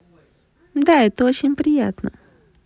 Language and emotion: Russian, positive